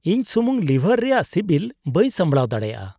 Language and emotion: Santali, disgusted